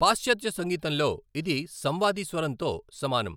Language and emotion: Telugu, neutral